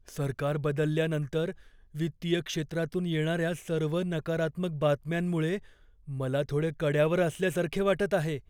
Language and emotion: Marathi, fearful